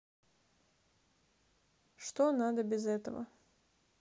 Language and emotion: Russian, neutral